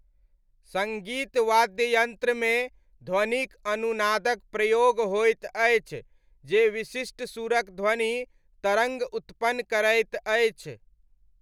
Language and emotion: Maithili, neutral